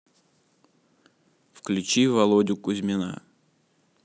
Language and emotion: Russian, neutral